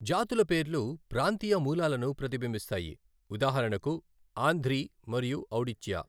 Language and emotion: Telugu, neutral